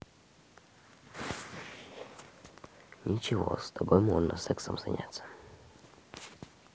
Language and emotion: Russian, neutral